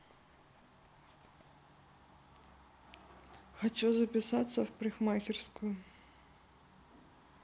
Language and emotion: Russian, neutral